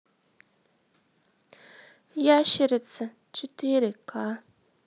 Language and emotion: Russian, sad